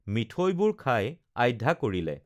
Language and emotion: Assamese, neutral